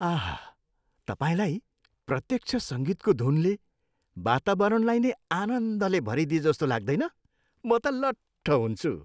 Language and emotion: Nepali, happy